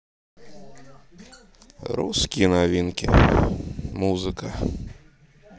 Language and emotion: Russian, neutral